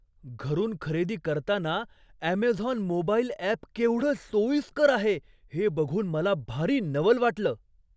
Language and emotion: Marathi, surprised